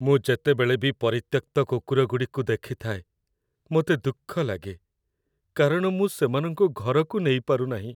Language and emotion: Odia, sad